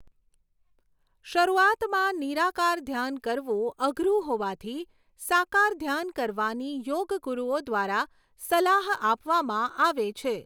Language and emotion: Gujarati, neutral